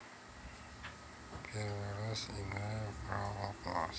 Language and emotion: Russian, neutral